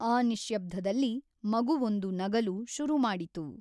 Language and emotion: Kannada, neutral